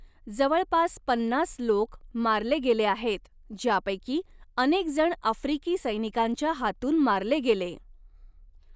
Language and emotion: Marathi, neutral